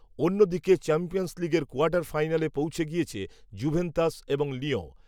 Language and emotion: Bengali, neutral